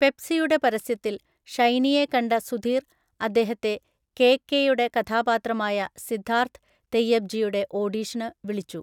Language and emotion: Malayalam, neutral